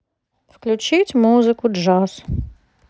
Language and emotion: Russian, neutral